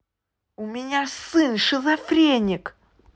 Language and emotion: Russian, angry